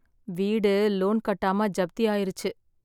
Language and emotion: Tamil, sad